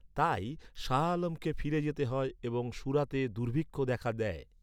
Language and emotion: Bengali, neutral